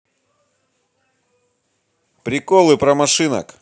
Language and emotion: Russian, positive